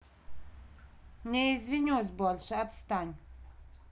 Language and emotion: Russian, angry